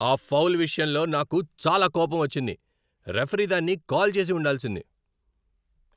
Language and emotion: Telugu, angry